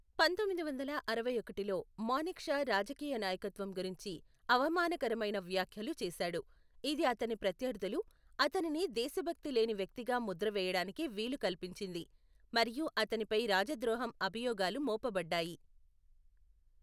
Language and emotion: Telugu, neutral